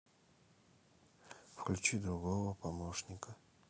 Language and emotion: Russian, neutral